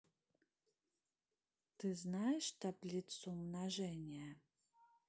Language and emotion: Russian, neutral